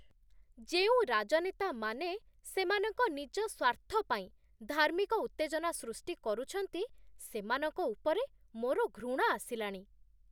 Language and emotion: Odia, disgusted